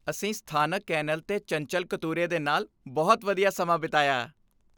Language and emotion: Punjabi, happy